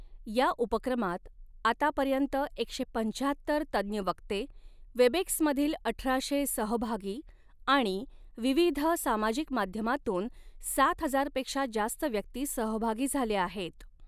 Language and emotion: Marathi, neutral